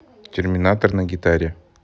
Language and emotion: Russian, neutral